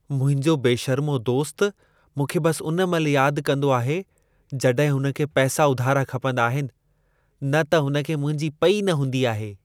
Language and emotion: Sindhi, disgusted